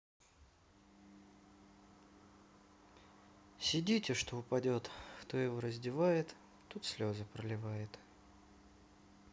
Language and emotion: Russian, sad